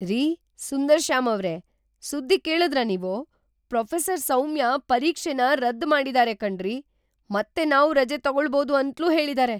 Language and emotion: Kannada, surprised